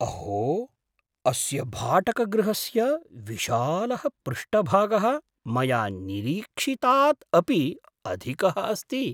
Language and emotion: Sanskrit, surprised